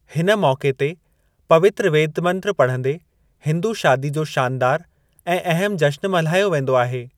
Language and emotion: Sindhi, neutral